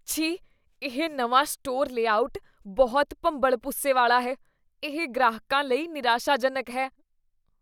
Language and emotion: Punjabi, disgusted